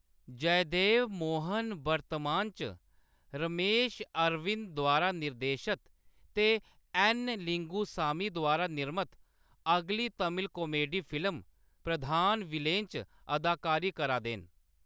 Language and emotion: Dogri, neutral